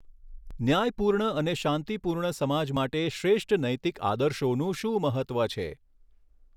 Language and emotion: Gujarati, neutral